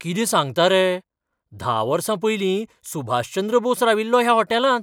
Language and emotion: Goan Konkani, surprised